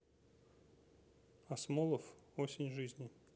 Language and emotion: Russian, neutral